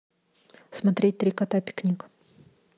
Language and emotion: Russian, neutral